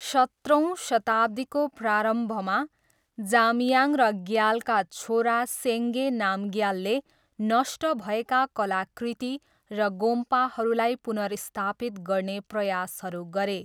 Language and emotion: Nepali, neutral